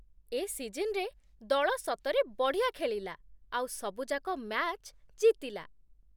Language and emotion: Odia, happy